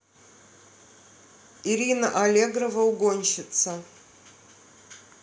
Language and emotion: Russian, neutral